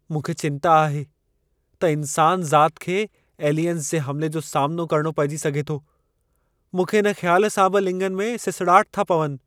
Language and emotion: Sindhi, fearful